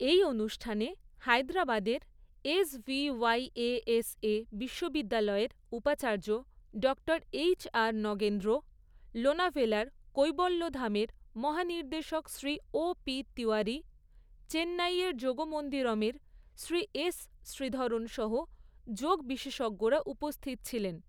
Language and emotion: Bengali, neutral